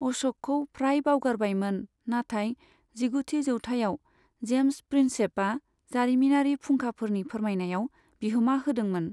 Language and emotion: Bodo, neutral